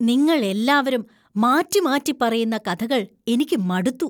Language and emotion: Malayalam, disgusted